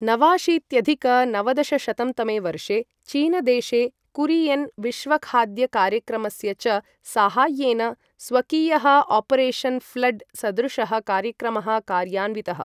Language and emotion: Sanskrit, neutral